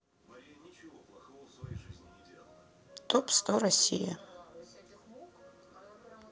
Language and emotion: Russian, neutral